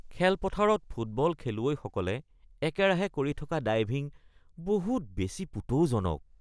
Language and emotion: Assamese, disgusted